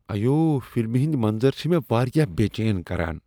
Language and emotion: Kashmiri, disgusted